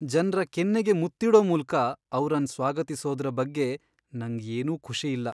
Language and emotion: Kannada, sad